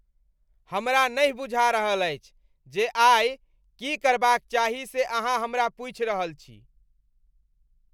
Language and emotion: Maithili, disgusted